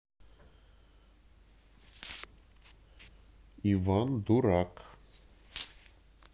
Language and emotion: Russian, neutral